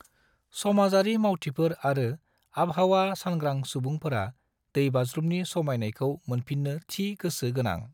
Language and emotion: Bodo, neutral